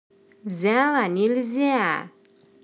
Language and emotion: Russian, angry